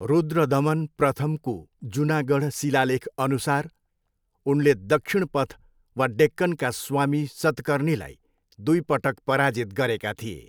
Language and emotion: Nepali, neutral